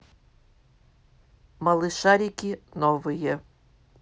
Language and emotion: Russian, neutral